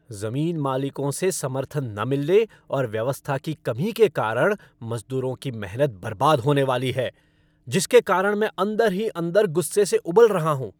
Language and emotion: Hindi, angry